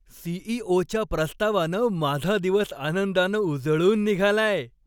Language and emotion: Marathi, happy